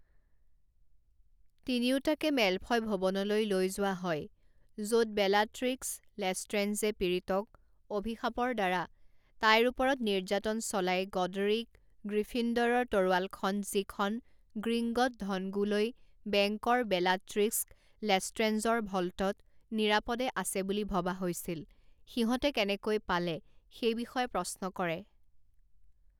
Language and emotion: Assamese, neutral